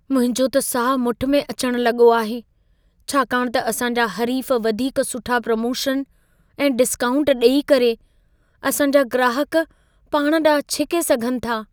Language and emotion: Sindhi, fearful